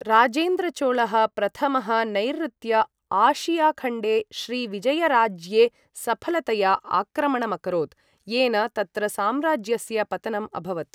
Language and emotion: Sanskrit, neutral